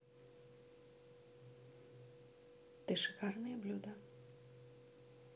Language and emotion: Russian, neutral